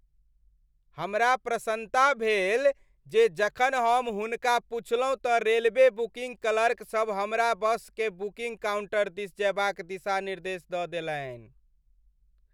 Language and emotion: Maithili, happy